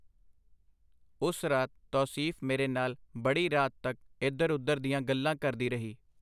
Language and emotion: Punjabi, neutral